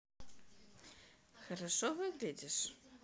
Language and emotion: Russian, positive